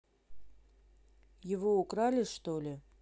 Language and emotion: Russian, neutral